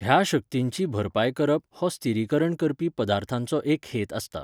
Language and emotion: Goan Konkani, neutral